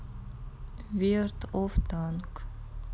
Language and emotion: Russian, neutral